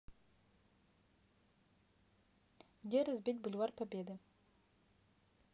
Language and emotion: Russian, neutral